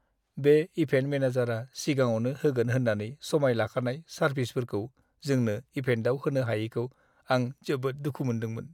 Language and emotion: Bodo, sad